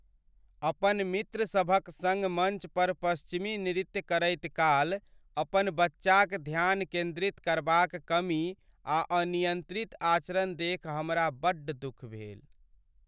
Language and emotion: Maithili, sad